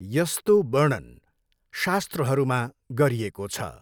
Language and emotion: Nepali, neutral